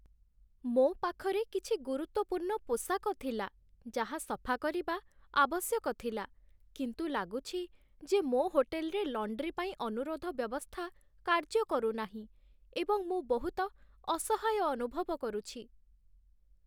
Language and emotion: Odia, sad